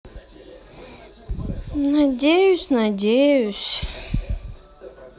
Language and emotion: Russian, sad